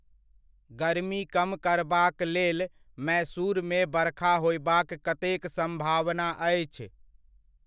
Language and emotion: Maithili, neutral